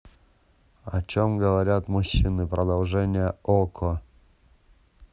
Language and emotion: Russian, neutral